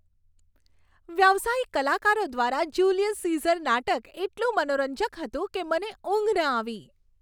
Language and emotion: Gujarati, happy